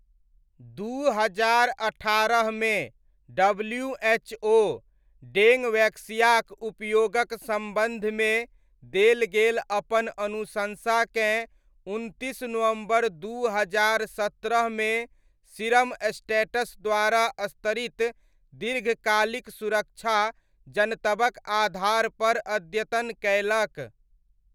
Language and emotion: Maithili, neutral